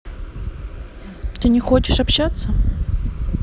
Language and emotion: Russian, neutral